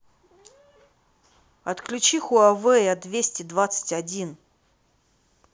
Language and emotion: Russian, angry